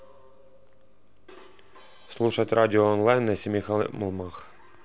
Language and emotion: Russian, neutral